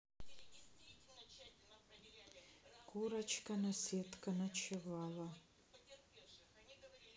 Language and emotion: Russian, sad